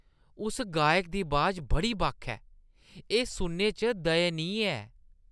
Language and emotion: Dogri, disgusted